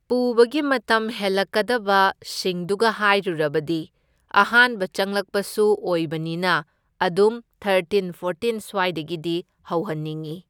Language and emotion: Manipuri, neutral